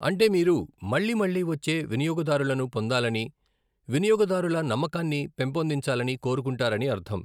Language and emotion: Telugu, neutral